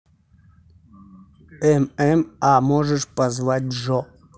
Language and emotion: Russian, neutral